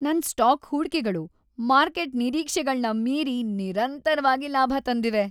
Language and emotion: Kannada, happy